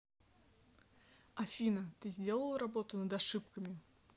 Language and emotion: Russian, neutral